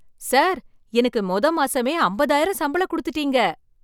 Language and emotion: Tamil, surprised